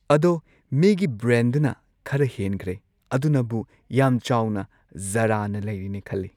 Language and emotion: Manipuri, neutral